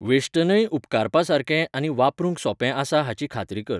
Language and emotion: Goan Konkani, neutral